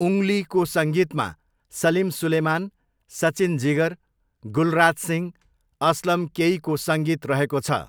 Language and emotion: Nepali, neutral